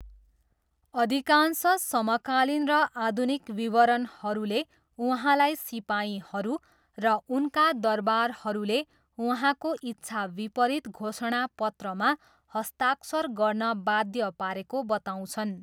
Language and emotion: Nepali, neutral